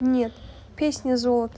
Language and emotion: Russian, neutral